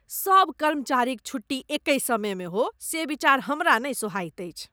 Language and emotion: Maithili, disgusted